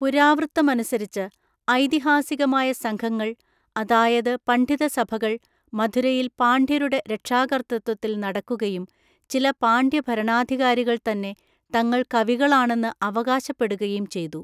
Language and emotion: Malayalam, neutral